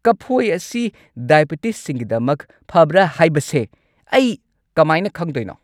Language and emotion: Manipuri, angry